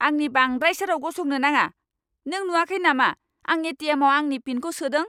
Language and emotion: Bodo, angry